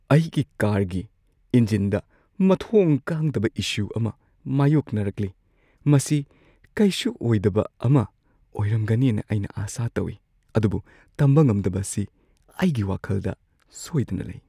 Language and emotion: Manipuri, fearful